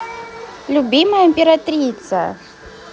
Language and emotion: Russian, neutral